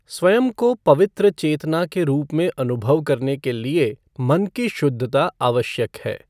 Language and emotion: Hindi, neutral